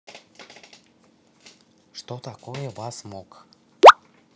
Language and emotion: Russian, neutral